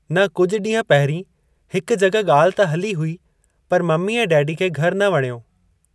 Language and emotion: Sindhi, neutral